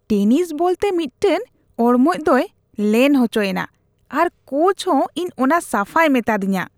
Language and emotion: Santali, disgusted